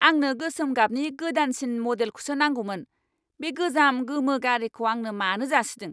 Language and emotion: Bodo, angry